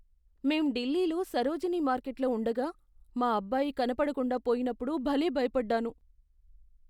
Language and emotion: Telugu, fearful